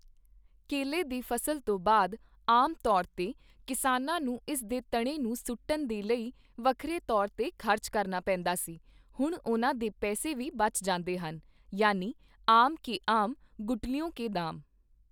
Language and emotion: Punjabi, neutral